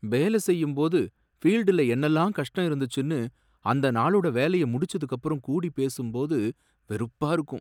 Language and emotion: Tamil, sad